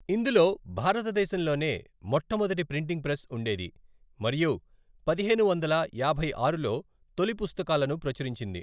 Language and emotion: Telugu, neutral